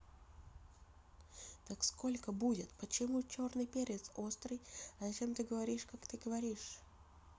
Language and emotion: Russian, neutral